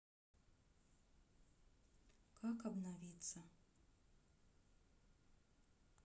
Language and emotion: Russian, sad